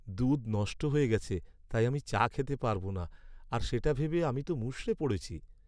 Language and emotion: Bengali, sad